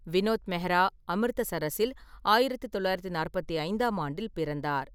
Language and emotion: Tamil, neutral